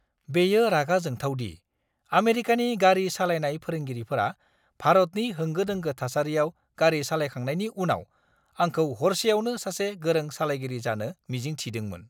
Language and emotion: Bodo, angry